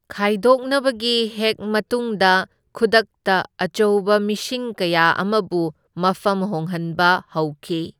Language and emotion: Manipuri, neutral